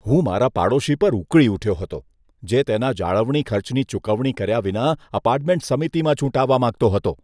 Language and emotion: Gujarati, disgusted